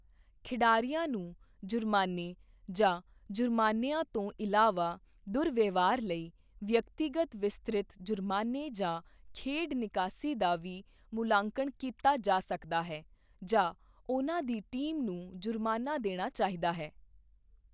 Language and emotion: Punjabi, neutral